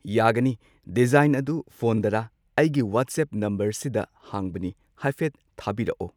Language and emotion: Manipuri, neutral